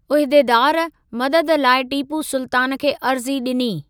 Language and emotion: Sindhi, neutral